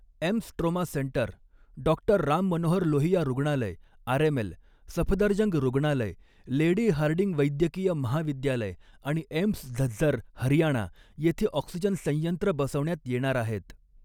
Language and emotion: Marathi, neutral